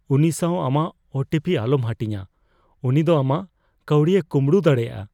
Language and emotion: Santali, fearful